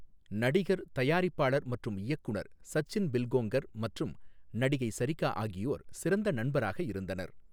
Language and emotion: Tamil, neutral